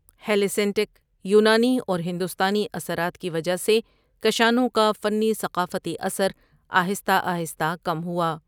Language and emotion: Urdu, neutral